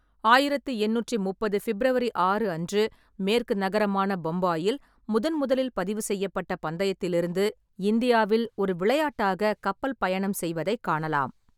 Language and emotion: Tamil, neutral